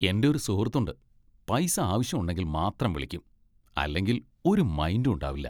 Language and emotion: Malayalam, disgusted